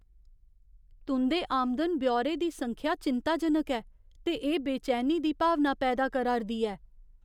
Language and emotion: Dogri, fearful